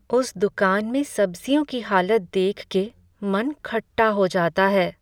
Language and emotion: Hindi, sad